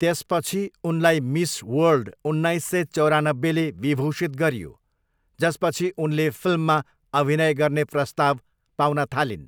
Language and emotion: Nepali, neutral